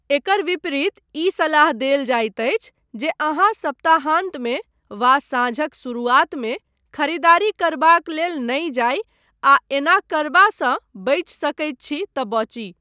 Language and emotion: Maithili, neutral